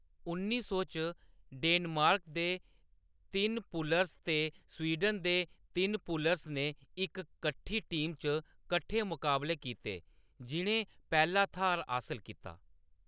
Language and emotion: Dogri, neutral